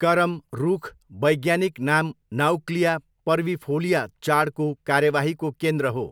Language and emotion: Nepali, neutral